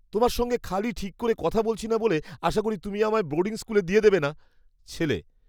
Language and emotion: Bengali, fearful